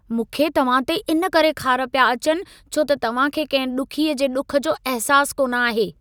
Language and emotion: Sindhi, angry